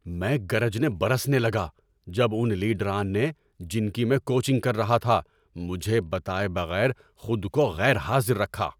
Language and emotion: Urdu, angry